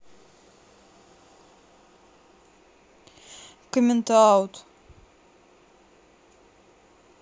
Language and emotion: Russian, neutral